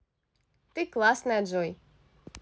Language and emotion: Russian, positive